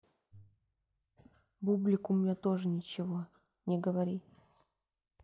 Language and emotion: Russian, neutral